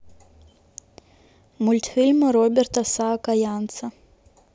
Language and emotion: Russian, neutral